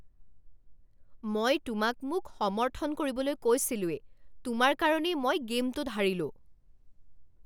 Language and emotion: Assamese, angry